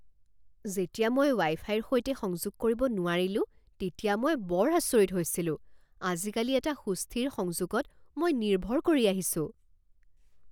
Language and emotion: Assamese, surprised